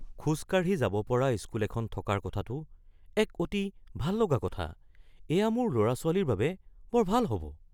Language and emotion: Assamese, surprised